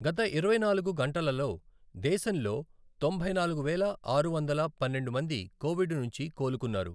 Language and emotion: Telugu, neutral